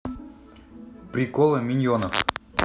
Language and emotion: Russian, neutral